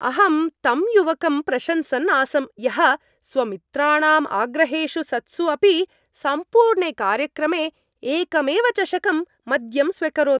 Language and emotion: Sanskrit, happy